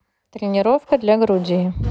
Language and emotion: Russian, neutral